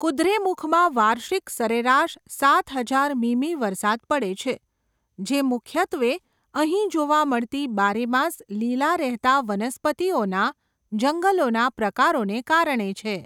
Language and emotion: Gujarati, neutral